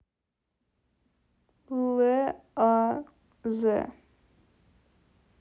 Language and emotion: Russian, neutral